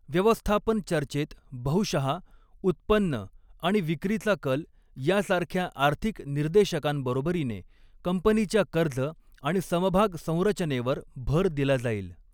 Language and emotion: Marathi, neutral